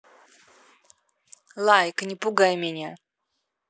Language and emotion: Russian, neutral